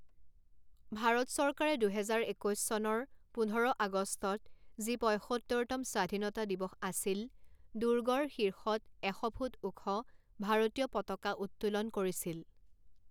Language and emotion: Assamese, neutral